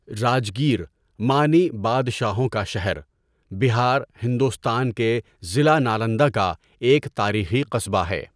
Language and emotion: Urdu, neutral